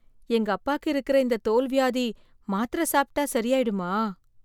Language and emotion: Tamil, fearful